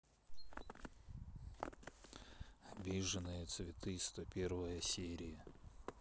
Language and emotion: Russian, neutral